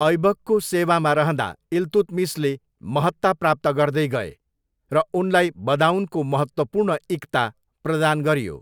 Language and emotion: Nepali, neutral